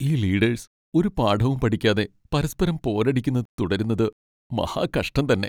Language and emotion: Malayalam, sad